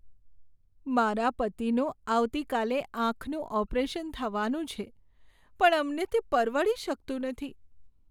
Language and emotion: Gujarati, sad